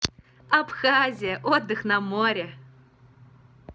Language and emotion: Russian, positive